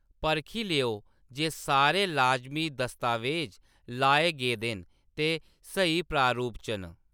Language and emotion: Dogri, neutral